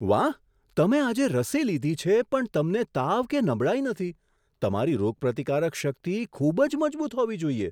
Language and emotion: Gujarati, surprised